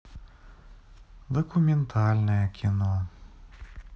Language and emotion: Russian, sad